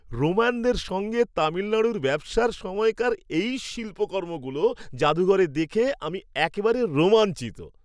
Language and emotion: Bengali, happy